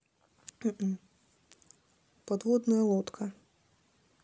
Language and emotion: Russian, neutral